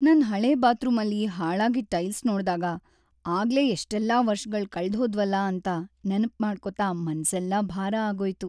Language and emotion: Kannada, sad